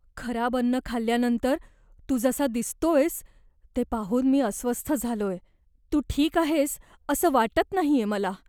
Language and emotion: Marathi, fearful